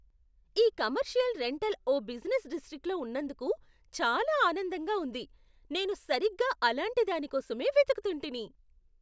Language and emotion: Telugu, surprised